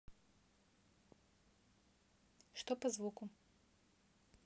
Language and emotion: Russian, neutral